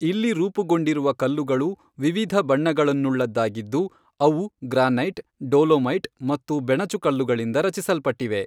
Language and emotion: Kannada, neutral